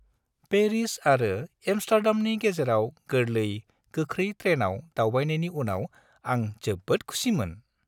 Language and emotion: Bodo, happy